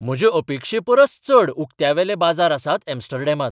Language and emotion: Goan Konkani, surprised